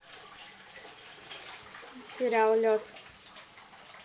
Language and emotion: Russian, neutral